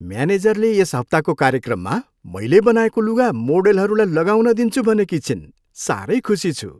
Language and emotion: Nepali, happy